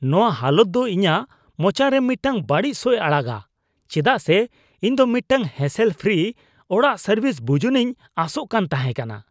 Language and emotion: Santali, disgusted